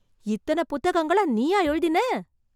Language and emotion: Tamil, surprised